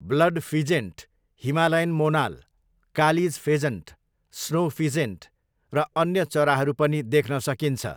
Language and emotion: Nepali, neutral